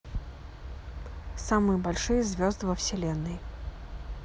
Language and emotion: Russian, neutral